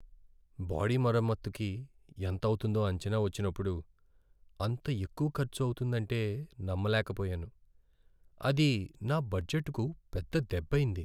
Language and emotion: Telugu, sad